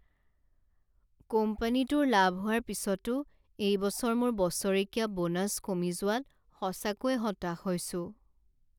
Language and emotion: Assamese, sad